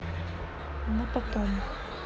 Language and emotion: Russian, neutral